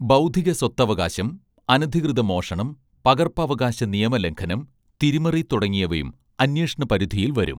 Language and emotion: Malayalam, neutral